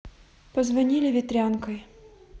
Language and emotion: Russian, neutral